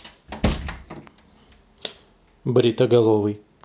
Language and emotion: Russian, neutral